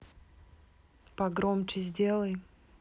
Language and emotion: Russian, neutral